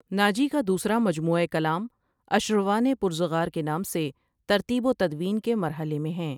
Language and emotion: Urdu, neutral